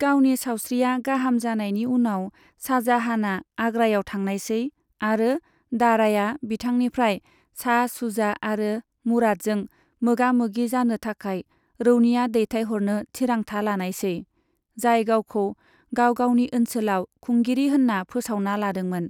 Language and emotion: Bodo, neutral